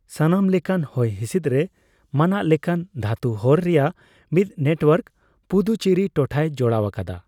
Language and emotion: Santali, neutral